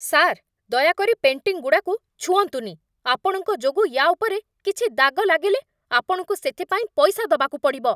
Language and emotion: Odia, angry